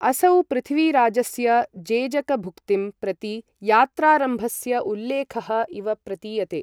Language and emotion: Sanskrit, neutral